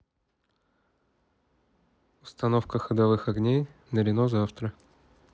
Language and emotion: Russian, neutral